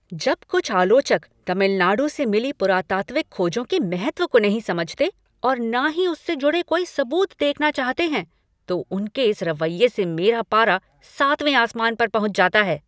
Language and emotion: Hindi, angry